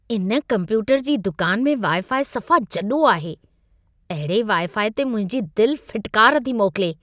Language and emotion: Sindhi, disgusted